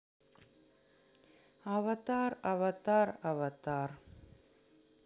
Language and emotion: Russian, neutral